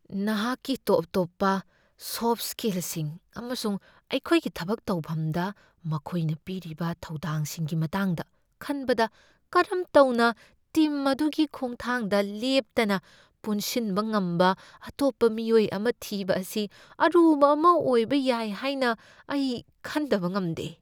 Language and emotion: Manipuri, fearful